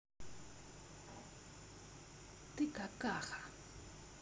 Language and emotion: Russian, angry